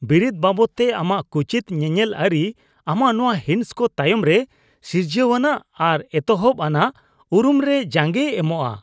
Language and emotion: Santali, disgusted